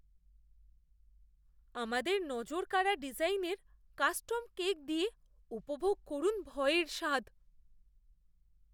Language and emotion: Bengali, fearful